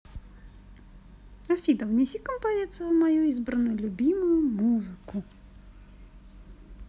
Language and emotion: Russian, positive